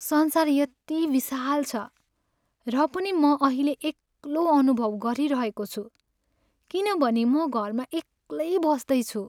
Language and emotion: Nepali, sad